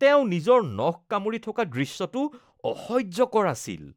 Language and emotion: Assamese, disgusted